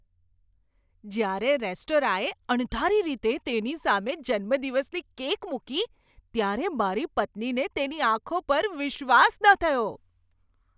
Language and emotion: Gujarati, surprised